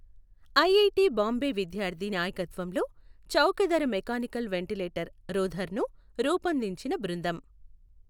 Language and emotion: Telugu, neutral